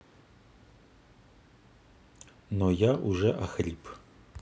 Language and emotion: Russian, neutral